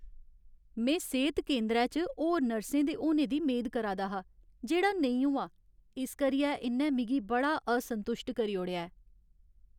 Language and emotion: Dogri, sad